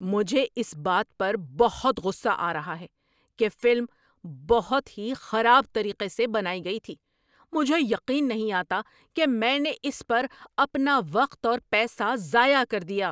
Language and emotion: Urdu, angry